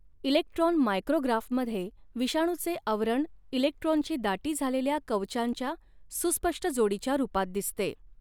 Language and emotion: Marathi, neutral